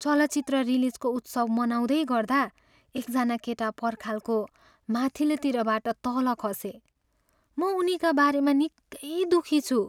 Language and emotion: Nepali, sad